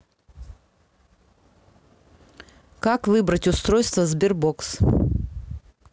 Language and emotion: Russian, neutral